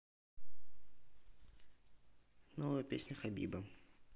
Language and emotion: Russian, neutral